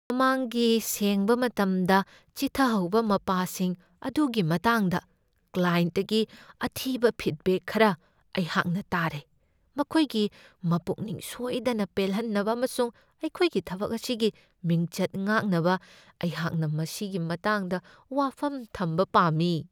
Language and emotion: Manipuri, fearful